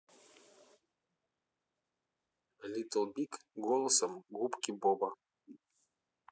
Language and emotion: Russian, neutral